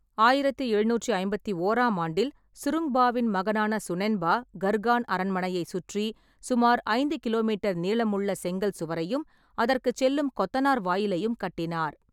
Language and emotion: Tamil, neutral